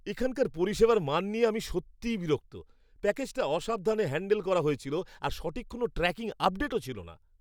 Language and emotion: Bengali, angry